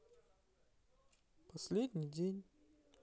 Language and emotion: Russian, neutral